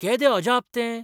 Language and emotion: Goan Konkani, surprised